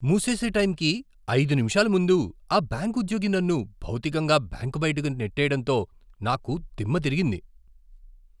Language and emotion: Telugu, surprised